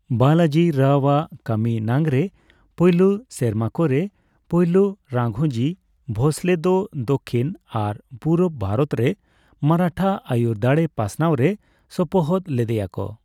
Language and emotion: Santali, neutral